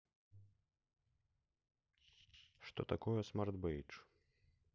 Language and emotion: Russian, neutral